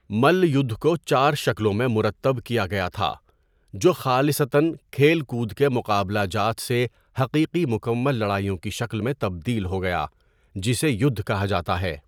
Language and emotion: Urdu, neutral